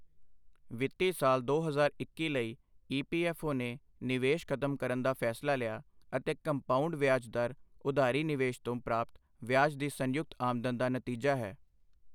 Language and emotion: Punjabi, neutral